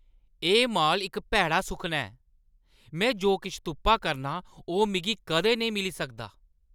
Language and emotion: Dogri, angry